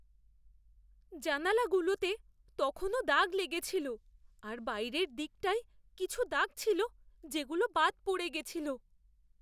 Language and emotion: Bengali, fearful